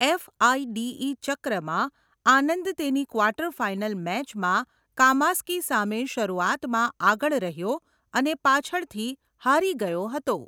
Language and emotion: Gujarati, neutral